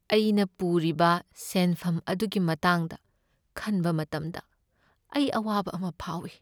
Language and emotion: Manipuri, sad